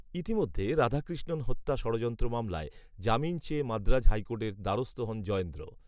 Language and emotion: Bengali, neutral